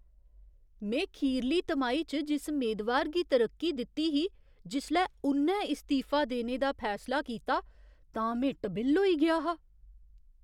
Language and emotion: Dogri, surprised